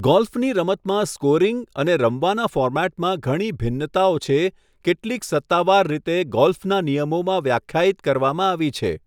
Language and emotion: Gujarati, neutral